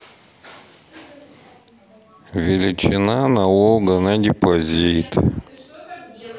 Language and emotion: Russian, neutral